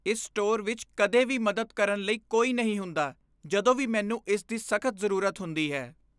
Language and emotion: Punjabi, disgusted